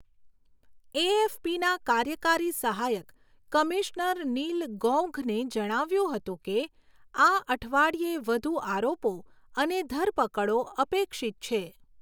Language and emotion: Gujarati, neutral